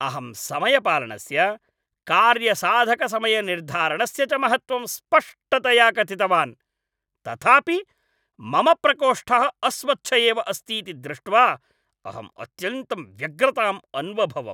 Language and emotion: Sanskrit, angry